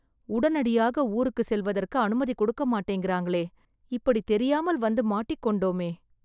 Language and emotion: Tamil, sad